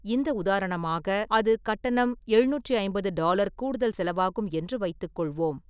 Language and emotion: Tamil, neutral